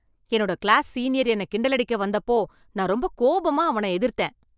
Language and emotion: Tamil, angry